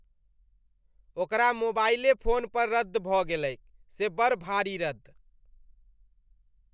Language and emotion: Maithili, disgusted